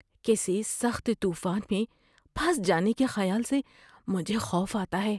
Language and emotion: Urdu, fearful